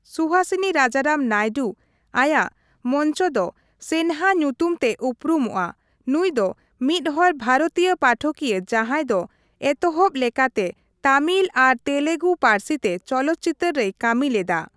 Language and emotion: Santali, neutral